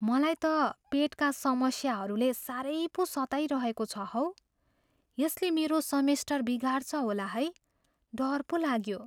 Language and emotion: Nepali, fearful